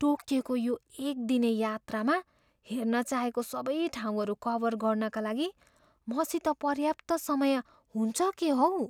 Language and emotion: Nepali, fearful